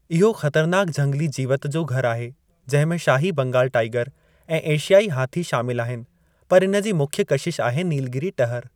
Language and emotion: Sindhi, neutral